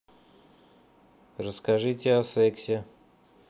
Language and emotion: Russian, neutral